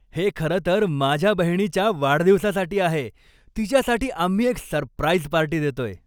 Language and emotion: Marathi, happy